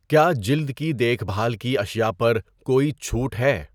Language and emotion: Urdu, neutral